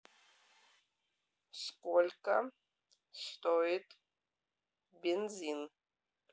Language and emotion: Russian, neutral